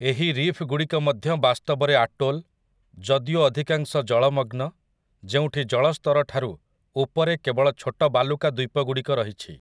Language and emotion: Odia, neutral